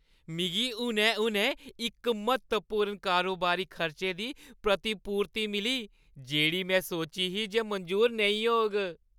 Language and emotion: Dogri, happy